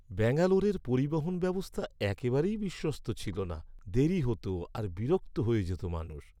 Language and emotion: Bengali, sad